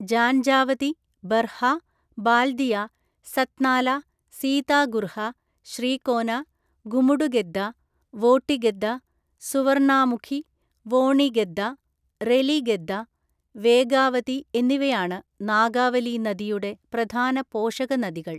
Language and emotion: Malayalam, neutral